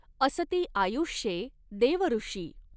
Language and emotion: Marathi, neutral